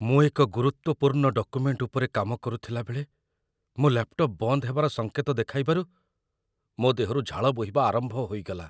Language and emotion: Odia, fearful